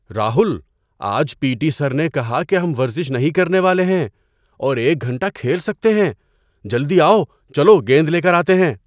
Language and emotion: Urdu, surprised